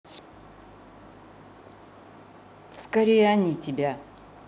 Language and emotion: Russian, neutral